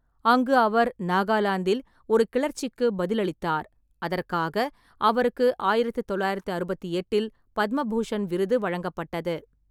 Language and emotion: Tamil, neutral